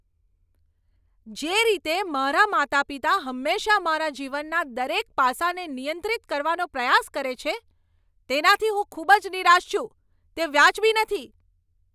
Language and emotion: Gujarati, angry